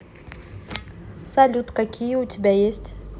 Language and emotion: Russian, neutral